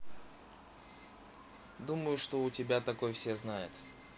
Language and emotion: Russian, neutral